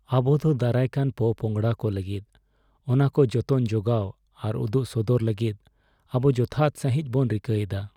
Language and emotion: Santali, sad